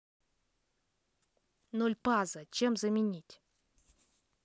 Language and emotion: Russian, neutral